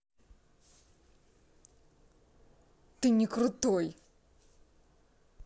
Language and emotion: Russian, angry